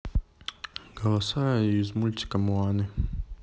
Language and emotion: Russian, neutral